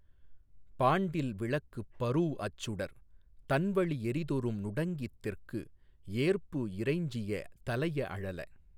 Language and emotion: Tamil, neutral